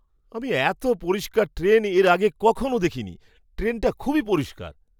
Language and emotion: Bengali, surprised